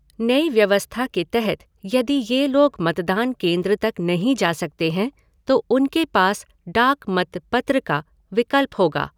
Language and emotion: Hindi, neutral